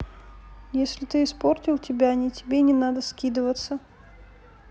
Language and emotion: Russian, neutral